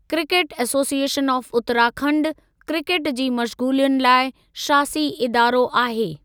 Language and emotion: Sindhi, neutral